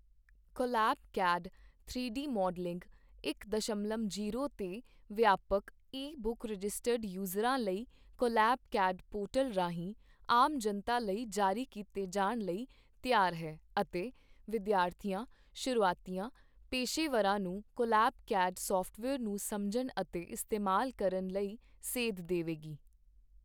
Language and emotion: Punjabi, neutral